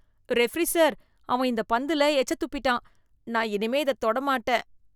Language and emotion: Tamil, disgusted